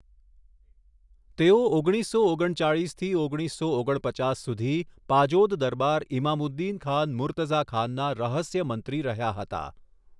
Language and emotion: Gujarati, neutral